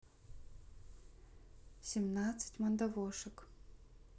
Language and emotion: Russian, neutral